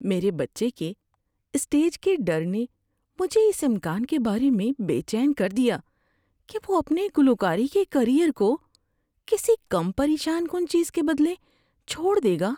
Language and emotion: Urdu, fearful